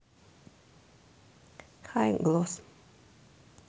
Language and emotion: Russian, neutral